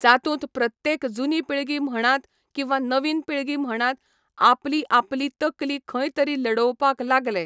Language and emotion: Goan Konkani, neutral